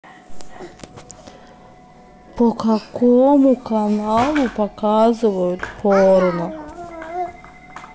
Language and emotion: Russian, neutral